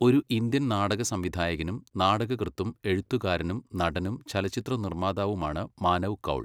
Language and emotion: Malayalam, neutral